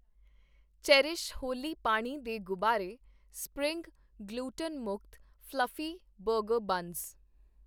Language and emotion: Punjabi, neutral